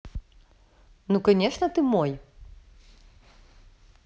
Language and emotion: Russian, neutral